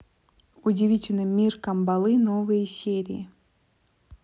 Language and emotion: Russian, neutral